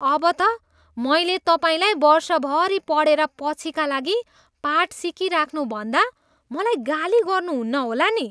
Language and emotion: Nepali, disgusted